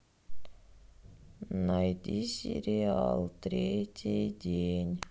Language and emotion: Russian, sad